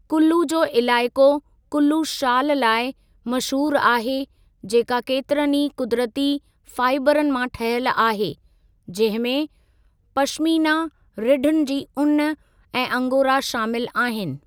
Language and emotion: Sindhi, neutral